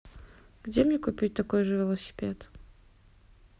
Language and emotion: Russian, neutral